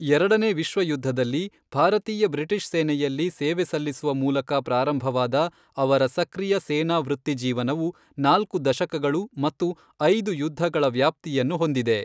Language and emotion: Kannada, neutral